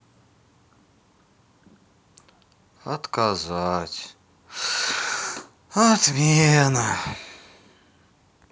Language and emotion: Russian, sad